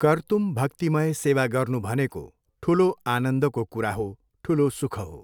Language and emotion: Nepali, neutral